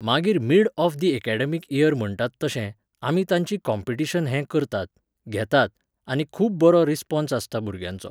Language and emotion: Goan Konkani, neutral